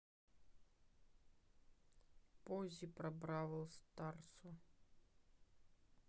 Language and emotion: Russian, neutral